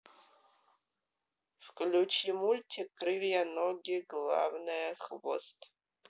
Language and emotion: Russian, neutral